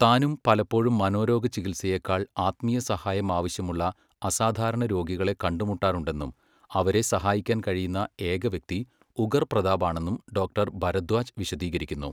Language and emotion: Malayalam, neutral